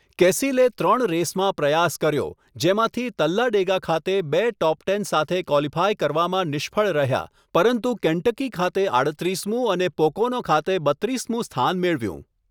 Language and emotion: Gujarati, neutral